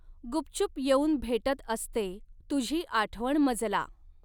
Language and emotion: Marathi, neutral